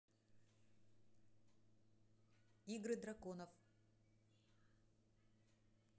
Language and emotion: Russian, neutral